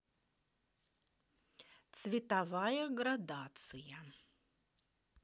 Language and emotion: Russian, positive